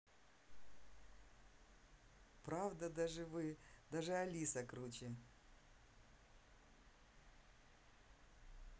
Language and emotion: Russian, positive